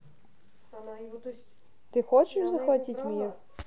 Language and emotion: Russian, neutral